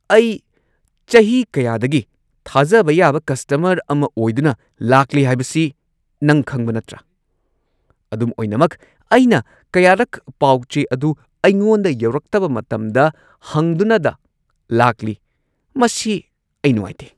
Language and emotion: Manipuri, angry